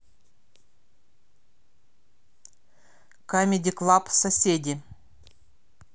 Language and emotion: Russian, neutral